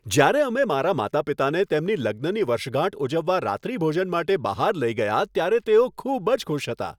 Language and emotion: Gujarati, happy